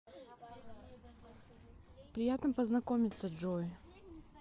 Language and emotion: Russian, neutral